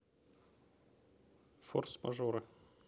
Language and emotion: Russian, neutral